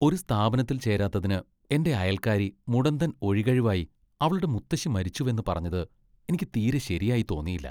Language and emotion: Malayalam, disgusted